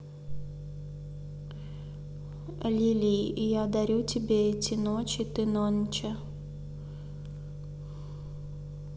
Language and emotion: Russian, neutral